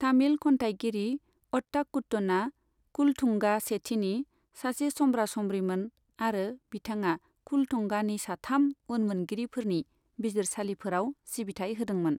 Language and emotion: Bodo, neutral